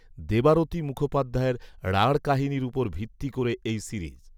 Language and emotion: Bengali, neutral